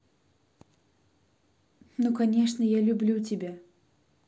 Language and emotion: Russian, positive